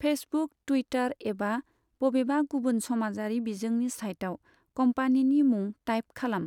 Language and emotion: Bodo, neutral